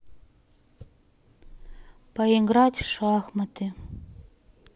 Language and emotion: Russian, sad